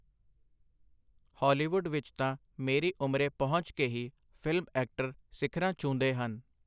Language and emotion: Punjabi, neutral